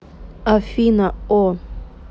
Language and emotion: Russian, neutral